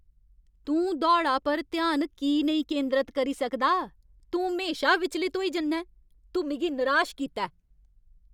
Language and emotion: Dogri, angry